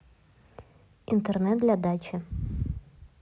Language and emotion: Russian, neutral